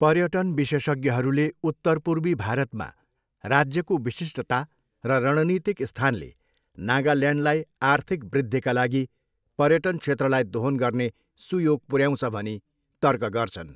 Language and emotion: Nepali, neutral